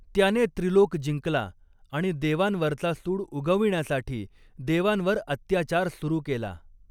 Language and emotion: Marathi, neutral